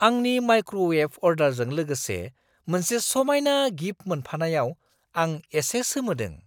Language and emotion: Bodo, surprised